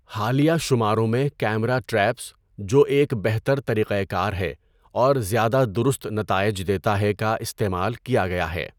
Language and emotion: Urdu, neutral